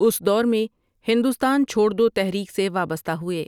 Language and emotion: Urdu, neutral